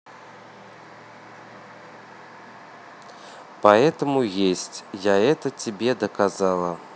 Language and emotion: Russian, neutral